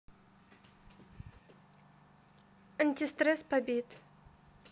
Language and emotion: Russian, neutral